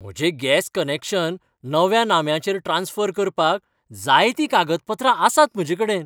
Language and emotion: Goan Konkani, happy